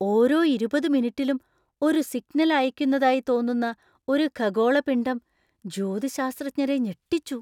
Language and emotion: Malayalam, surprised